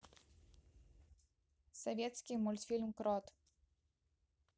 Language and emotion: Russian, neutral